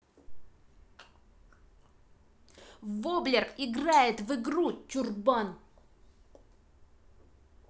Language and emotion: Russian, angry